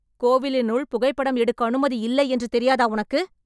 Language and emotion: Tamil, angry